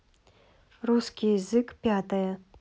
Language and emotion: Russian, neutral